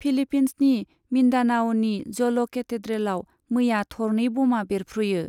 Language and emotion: Bodo, neutral